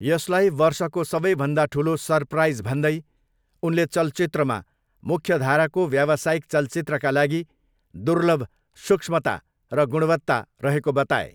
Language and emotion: Nepali, neutral